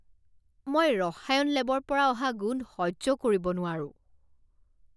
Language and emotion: Assamese, disgusted